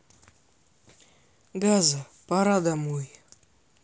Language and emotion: Russian, sad